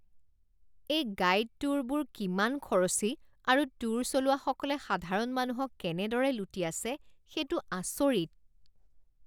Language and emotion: Assamese, disgusted